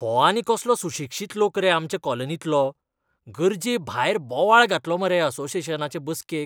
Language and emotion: Goan Konkani, disgusted